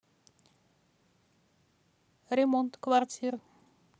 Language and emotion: Russian, neutral